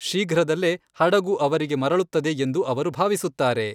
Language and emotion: Kannada, neutral